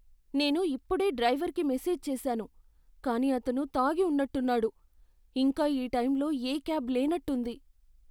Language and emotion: Telugu, fearful